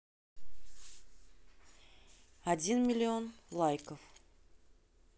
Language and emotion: Russian, neutral